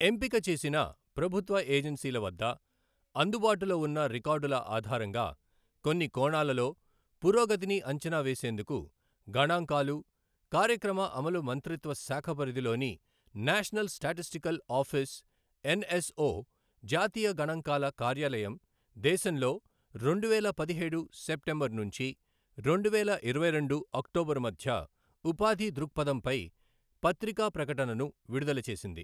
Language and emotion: Telugu, neutral